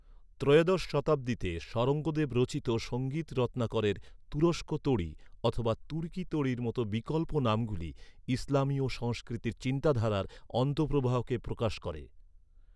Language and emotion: Bengali, neutral